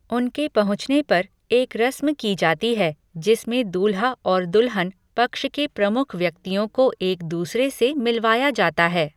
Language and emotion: Hindi, neutral